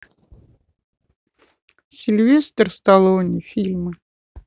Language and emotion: Russian, neutral